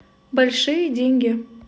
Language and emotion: Russian, neutral